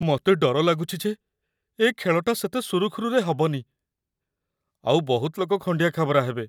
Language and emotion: Odia, fearful